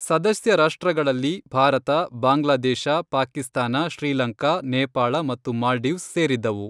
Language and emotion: Kannada, neutral